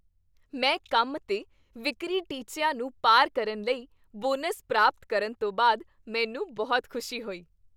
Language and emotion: Punjabi, happy